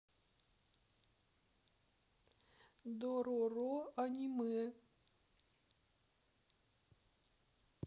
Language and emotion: Russian, sad